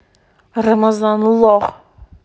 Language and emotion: Russian, angry